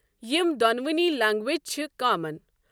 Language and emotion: Kashmiri, neutral